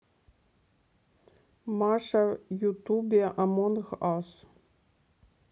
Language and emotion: Russian, neutral